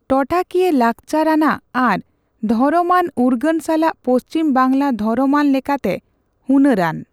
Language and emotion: Santali, neutral